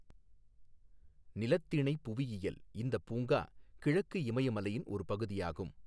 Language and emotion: Tamil, neutral